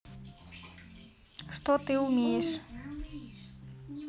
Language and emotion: Russian, neutral